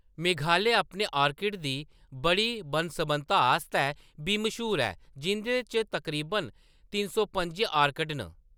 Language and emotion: Dogri, neutral